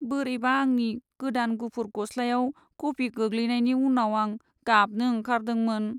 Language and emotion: Bodo, sad